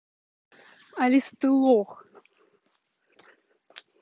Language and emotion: Russian, angry